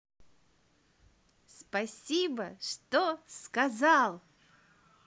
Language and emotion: Russian, positive